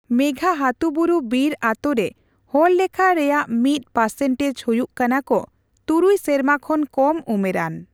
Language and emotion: Santali, neutral